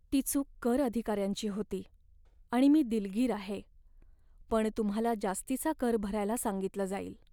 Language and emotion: Marathi, sad